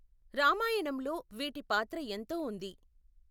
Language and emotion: Telugu, neutral